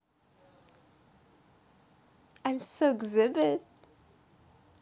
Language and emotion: Russian, positive